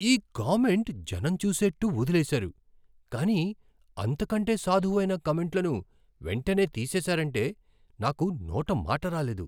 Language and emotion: Telugu, surprised